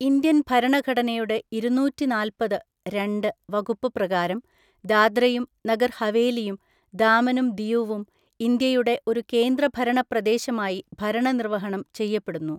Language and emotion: Malayalam, neutral